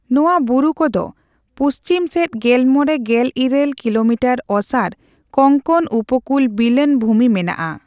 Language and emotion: Santali, neutral